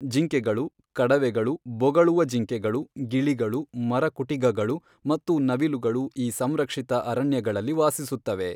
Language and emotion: Kannada, neutral